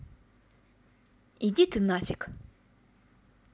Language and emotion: Russian, angry